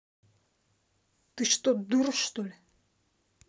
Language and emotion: Russian, angry